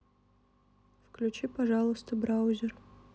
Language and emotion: Russian, neutral